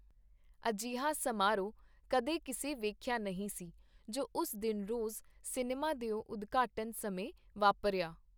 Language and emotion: Punjabi, neutral